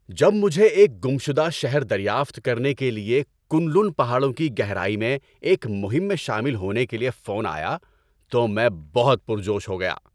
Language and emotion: Urdu, happy